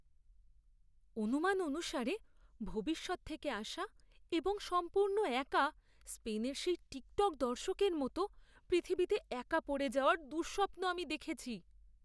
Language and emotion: Bengali, fearful